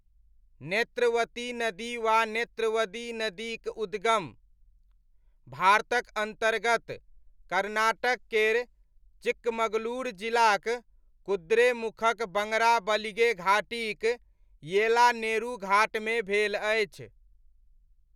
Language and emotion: Maithili, neutral